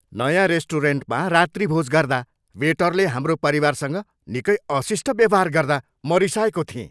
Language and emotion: Nepali, angry